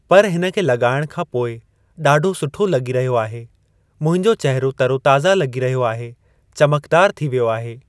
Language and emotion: Sindhi, neutral